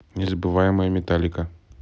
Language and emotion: Russian, neutral